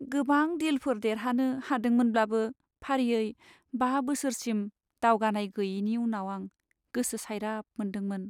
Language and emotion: Bodo, sad